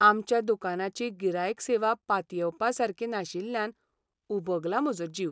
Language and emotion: Goan Konkani, sad